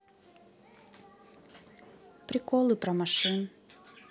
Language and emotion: Russian, neutral